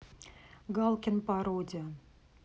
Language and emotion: Russian, neutral